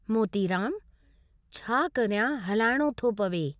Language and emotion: Sindhi, neutral